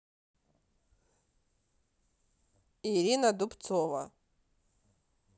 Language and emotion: Russian, neutral